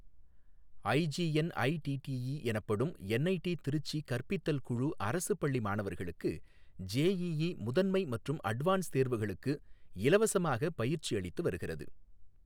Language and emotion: Tamil, neutral